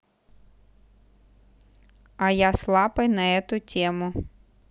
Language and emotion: Russian, neutral